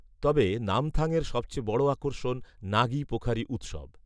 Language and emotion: Bengali, neutral